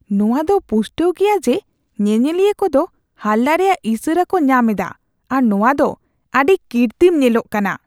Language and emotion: Santali, disgusted